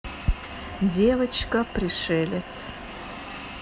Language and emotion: Russian, neutral